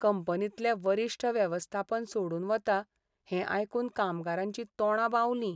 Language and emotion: Goan Konkani, sad